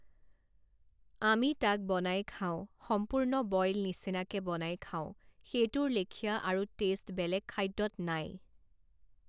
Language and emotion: Assamese, neutral